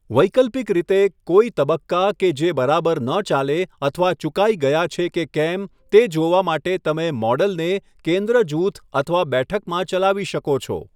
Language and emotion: Gujarati, neutral